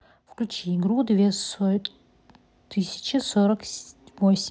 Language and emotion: Russian, neutral